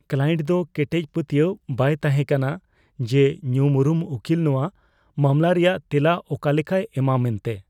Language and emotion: Santali, fearful